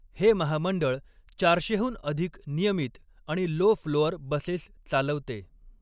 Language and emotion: Marathi, neutral